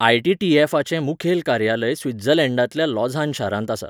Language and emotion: Goan Konkani, neutral